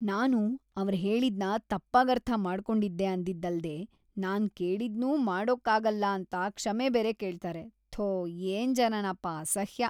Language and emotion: Kannada, disgusted